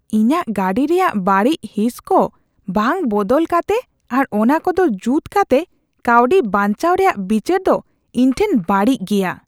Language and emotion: Santali, disgusted